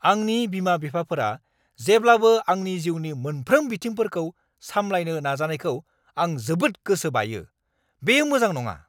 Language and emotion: Bodo, angry